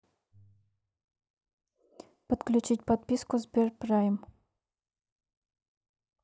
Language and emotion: Russian, neutral